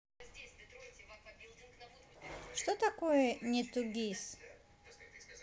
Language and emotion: Russian, neutral